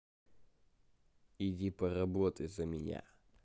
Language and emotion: Russian, neutral